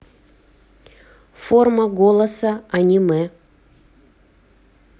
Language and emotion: Russian, neutral